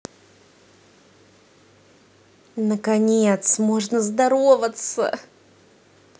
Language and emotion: Russian, positive